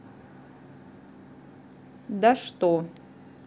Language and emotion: Russian, neutral